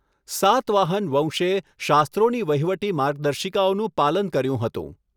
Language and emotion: Gujarati, neutral